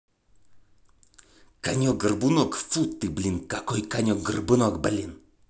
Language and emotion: Russian, angry